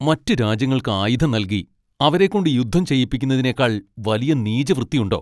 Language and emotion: Malayalam, angry